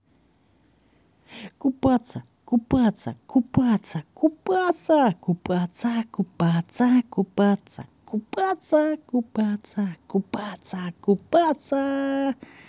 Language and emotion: Russian, positive